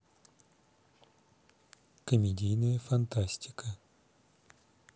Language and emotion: Russian, neutral